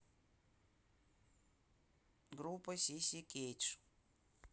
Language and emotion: Russian, neutral